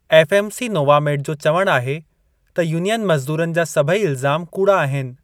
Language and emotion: Sindhi, neutral